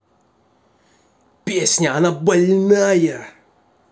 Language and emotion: Russian, angry